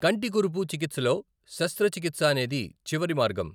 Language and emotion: Telugu, neutral